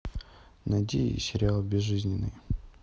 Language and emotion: Russian, neutral